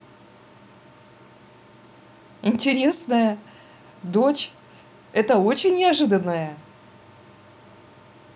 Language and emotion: Russian, positive